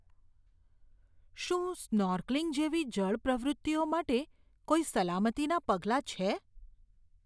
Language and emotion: Gujarati, fearful